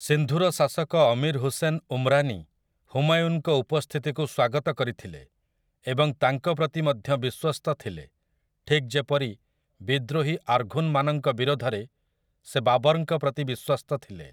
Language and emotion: Odia, neutral